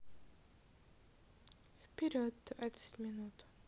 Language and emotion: Russian, neutral